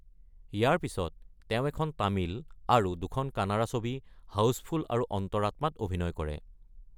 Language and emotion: Assamese, neutral